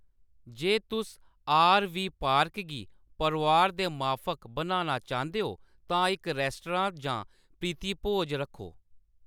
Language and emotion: Dogri, neutral